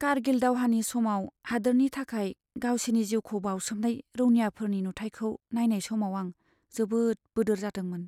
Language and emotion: Bodo, sad